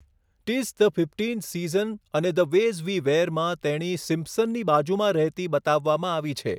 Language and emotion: Gujarati, neutral